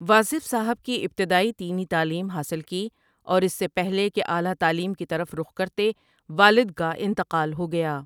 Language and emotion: Urdu, neutral